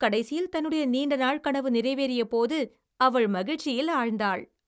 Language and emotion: Tamil, happy